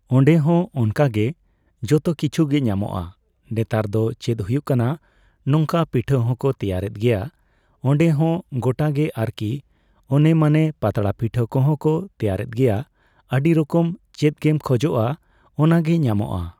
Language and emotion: Santali, neutral